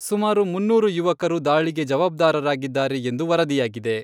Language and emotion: Kannada, neutral